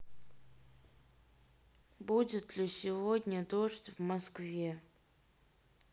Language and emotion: Russian, neutral